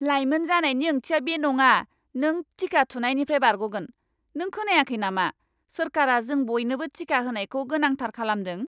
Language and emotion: Bodo, angry